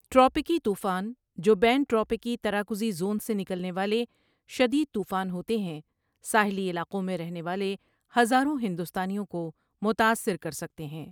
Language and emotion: Urdu, neutral